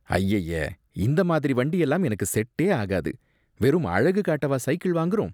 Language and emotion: Tamil, disgusted